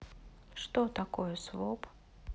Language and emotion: Russian, sad